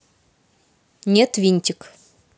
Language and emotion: Russian, neutral